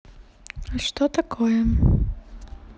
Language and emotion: Russian, sad